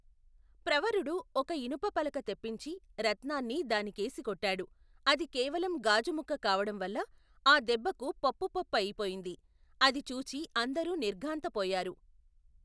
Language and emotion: Telugu, neutral